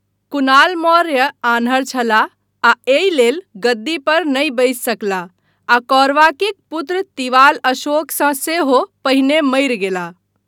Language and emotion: Maithili, neutral